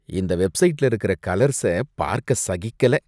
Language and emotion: Tamil, disgusted